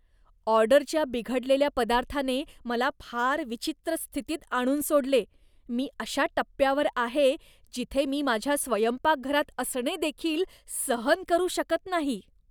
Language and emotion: Marathi, disgusted